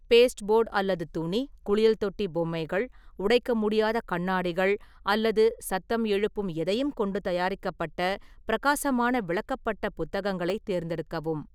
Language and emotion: Tamil, neutral